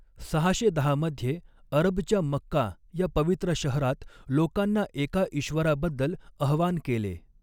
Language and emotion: Marathi, neutral